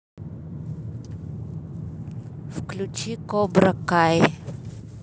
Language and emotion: Russian, neutral